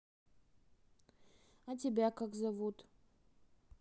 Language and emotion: Russian, neutral